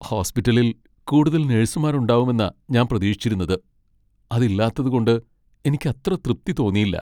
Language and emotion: Malayalam, sad